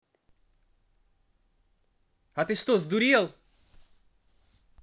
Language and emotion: Russian, angry